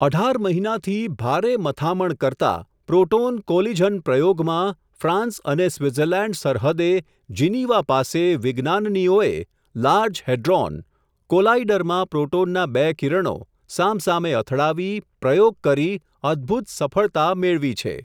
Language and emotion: Gujarati, neutral